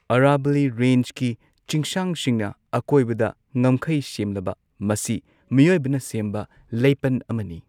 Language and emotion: Manipuri, neutral